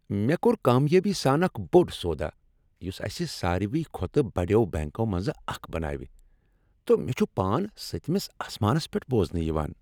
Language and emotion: Kashmiri, happy